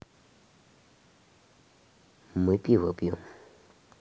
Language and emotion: Russian, neutral